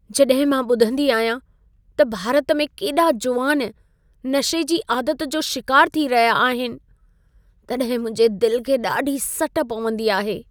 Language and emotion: Sindhi, sad